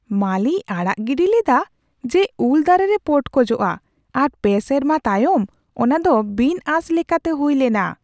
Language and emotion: Santali, surprised